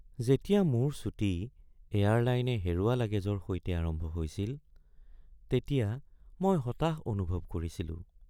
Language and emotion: Assamese, sad